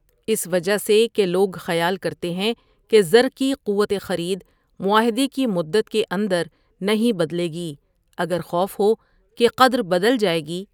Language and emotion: Urdu, neutral